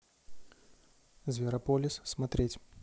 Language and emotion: Russian, neutral